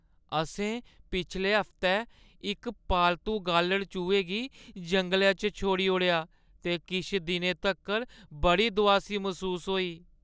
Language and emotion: Dogri, sad